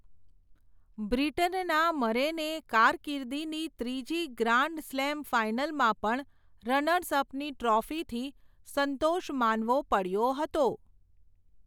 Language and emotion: Gujarati, neutral